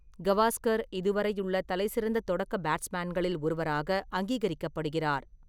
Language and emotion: Tamil, neutral